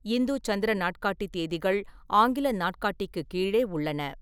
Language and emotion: Tamil, neutral